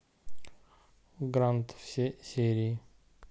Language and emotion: Russian, neutral